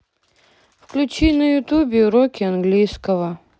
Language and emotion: Russian, sad